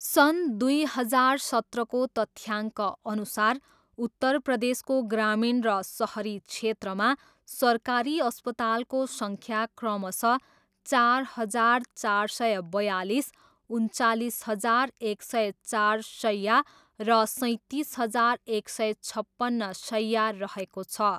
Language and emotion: Nepali, neutral